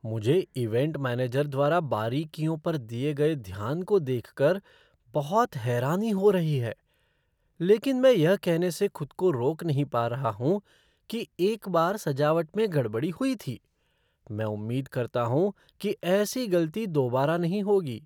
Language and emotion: Hindi, surprised